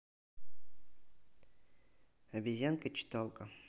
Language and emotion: Russian, neutral